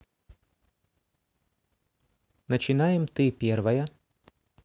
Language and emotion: Russian, neutral